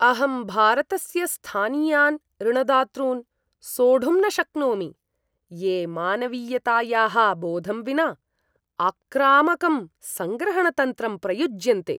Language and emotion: Sanskrit, disgusted